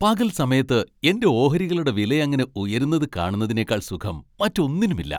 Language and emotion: Malayalam, happy